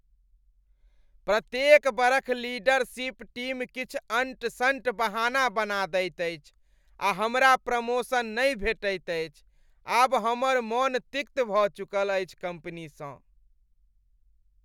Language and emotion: Maithili, disgusted